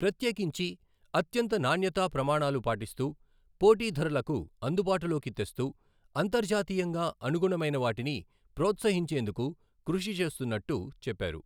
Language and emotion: Telugu, neutral